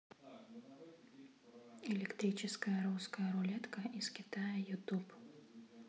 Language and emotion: Russian, neutral